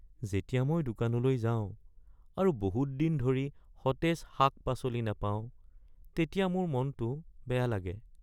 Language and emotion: Assamese, sad